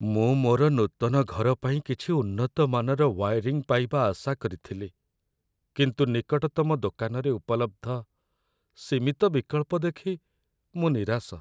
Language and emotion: Odia, sad